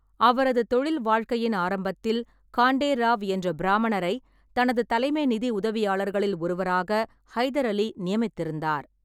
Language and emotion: Tamil, neutral